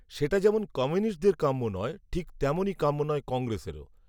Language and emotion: Bengali, neutral